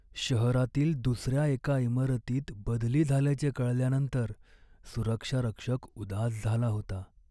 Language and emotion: Marathi, sad